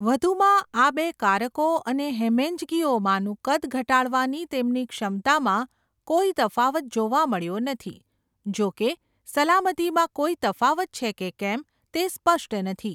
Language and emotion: Gujarati, neutral